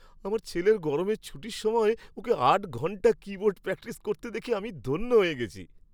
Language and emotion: Bengali, happy